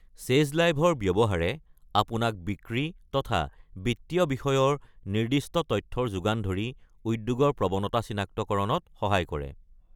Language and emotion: Assamese, neutral